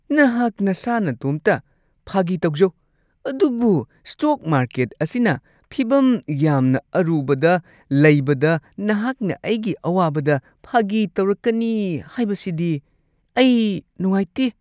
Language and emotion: Manipuri, disgusted